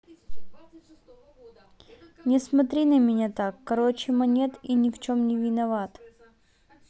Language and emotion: Russian, neutral